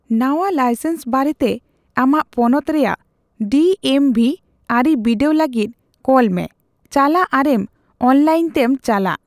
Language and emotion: Santali, neutral